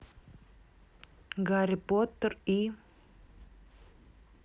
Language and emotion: Russian, neutral